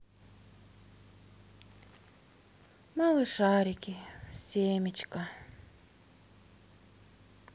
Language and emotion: Russian, sad